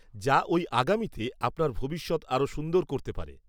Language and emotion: Bengali, neutral